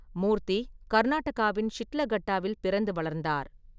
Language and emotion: Tamil, neutral